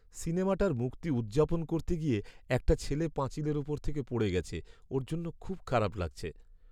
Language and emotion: Bengali, sad